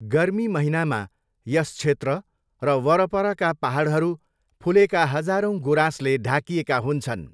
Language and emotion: Nepali, neutral